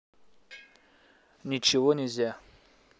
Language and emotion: Russian, neutral